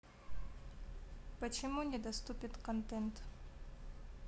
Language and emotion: Russian, neutral